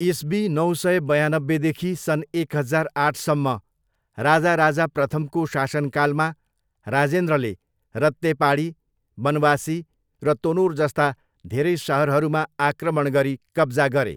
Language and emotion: Nepali, neutral